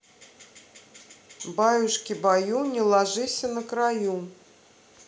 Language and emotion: Russian, neutral